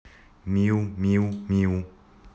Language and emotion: Russian, neutral